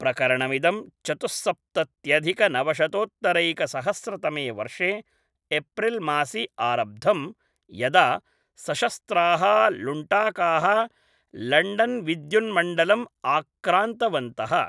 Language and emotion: Sanskrit, neutral